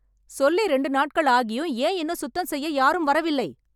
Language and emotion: Tamil, angry